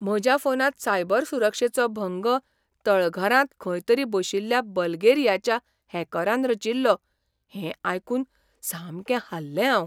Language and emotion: Goan Konkani, surprised